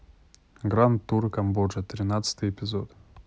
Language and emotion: Russian, neutral